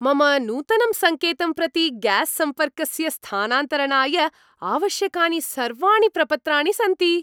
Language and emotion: Sanskrit, happy